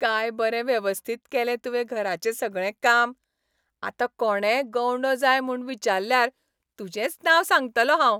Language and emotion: Goan Konkani, happy